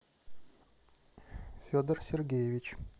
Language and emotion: Russian, neutral